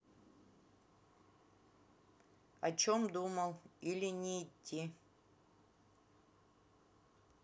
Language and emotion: Russian, neutral